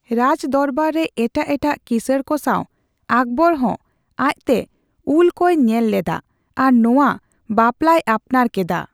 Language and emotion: Santali, neutral